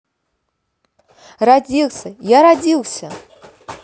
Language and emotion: Russian, positive